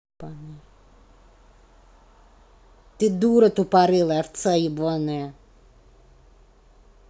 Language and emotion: Russian, angry